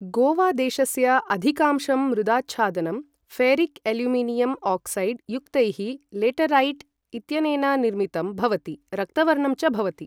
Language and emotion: Sanskrit, neutral